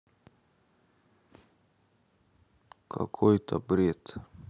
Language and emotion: Russian, neutral